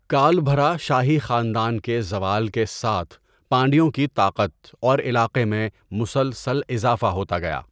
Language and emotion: Urdu, neutral